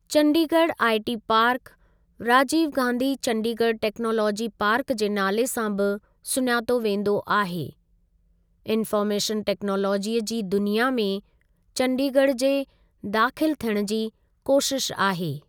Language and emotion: Sindhi, neutral